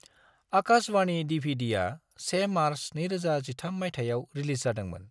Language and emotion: Bodo, neutral